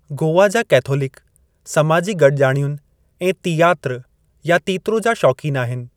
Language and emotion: Sindhi, neutral